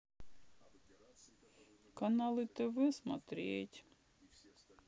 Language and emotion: Russian, sad